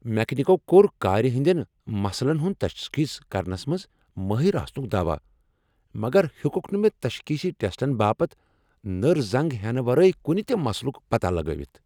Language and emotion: Kashmiri, angry